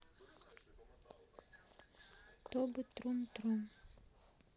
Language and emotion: Russian, sad